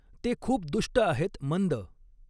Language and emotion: Marathi, neutral